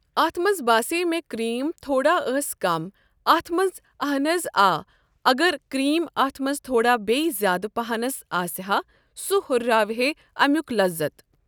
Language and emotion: Kashmiri, neutral